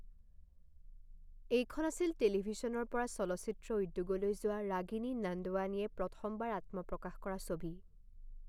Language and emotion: Assamese, neutral